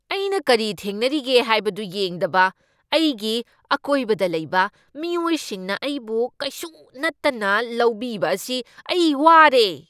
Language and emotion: Manipuri, angry